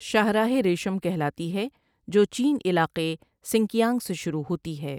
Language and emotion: Urdu, neutral